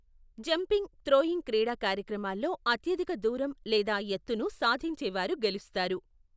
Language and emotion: Telugu, neutral